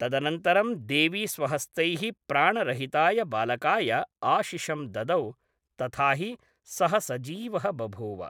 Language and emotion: Sanskrit, neutral